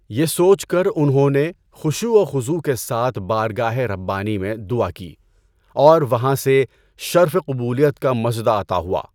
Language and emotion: Urdu, neutral